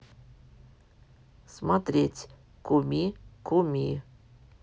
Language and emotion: Russian, neutral